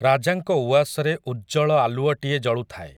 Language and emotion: Odia, neutral